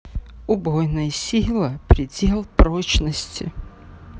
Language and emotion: Russian, sad